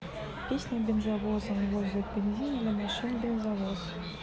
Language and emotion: Russian, neutral